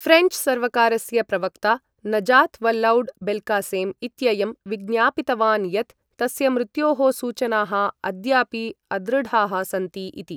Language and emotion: Sanskrit, neutral